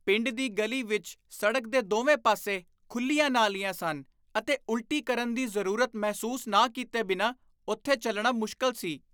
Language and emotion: Punjabi, disgusted